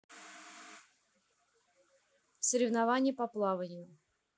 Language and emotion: Russian, neutral